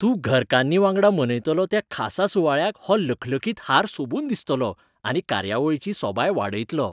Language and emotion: Goan Konkani, happy